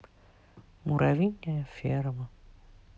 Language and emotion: Russian, sad